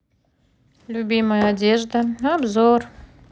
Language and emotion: Russian, neutral